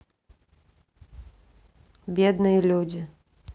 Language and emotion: Russian, neutral